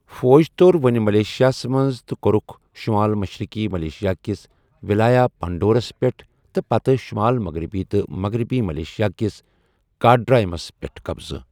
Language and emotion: Kashmiri, neutral